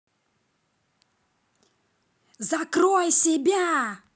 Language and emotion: Russian, angry